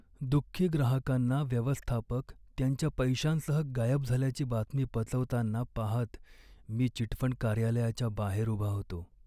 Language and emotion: Marathi, sad